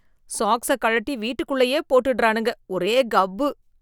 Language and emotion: Tamil, disgusted